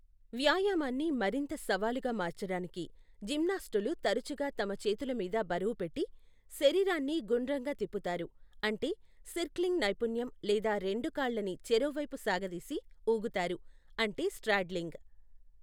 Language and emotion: Telugu, neutral